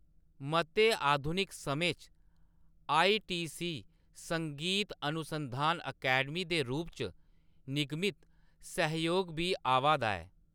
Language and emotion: Dogri, neutral